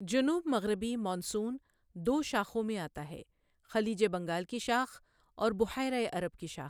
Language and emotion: Urdu, neutral